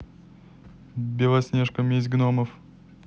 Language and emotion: Russian, neutral